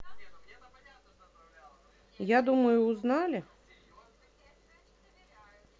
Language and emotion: Russian, neutral